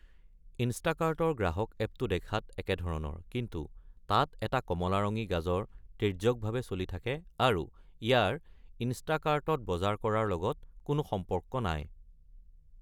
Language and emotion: Assamese, neutral